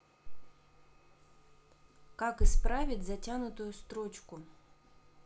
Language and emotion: Russian, neutral